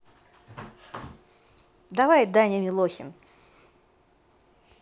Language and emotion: Russian, positive